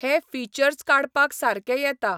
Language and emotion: Goan Konkani, neutral